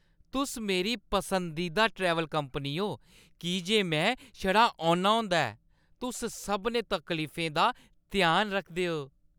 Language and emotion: Dogri, happy